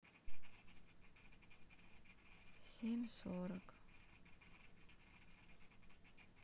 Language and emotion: Russian, sad